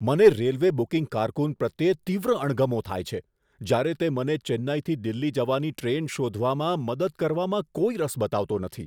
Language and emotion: Gujarati, disgusted